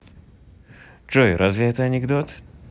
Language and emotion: Russian, neutral